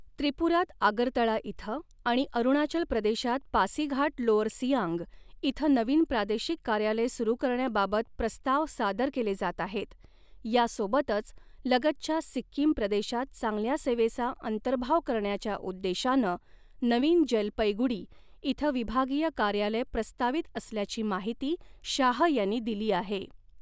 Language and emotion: Marathi, neutral